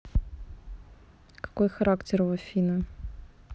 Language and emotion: Russian, neutral